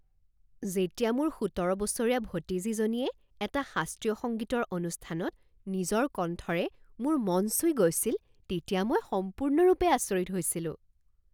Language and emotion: Assamese, surprised